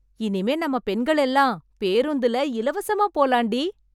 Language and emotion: Tamil, happy